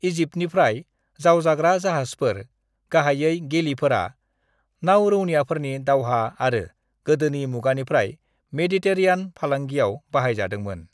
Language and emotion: Bodo, neutral